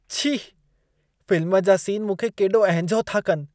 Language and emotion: Sindhi, disgusted